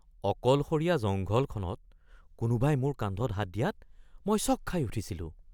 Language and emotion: Assamese, surprised